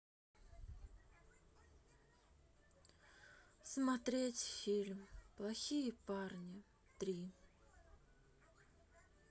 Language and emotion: Russian, sad